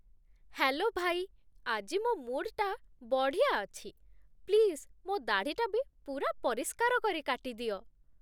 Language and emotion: Odia, happy